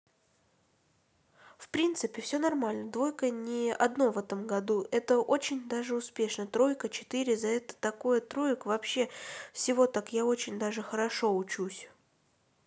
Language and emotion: Russian, neutral